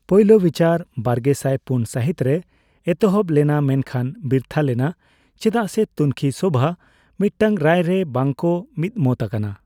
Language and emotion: Santali, neutral